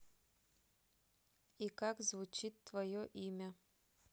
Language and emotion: Russian, neutral